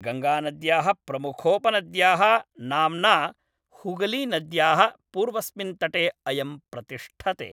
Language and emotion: Sanskrit, neutral